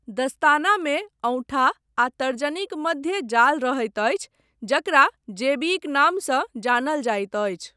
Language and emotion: Maithili, neutral